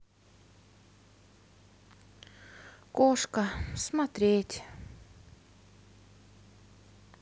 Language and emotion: Russian, sad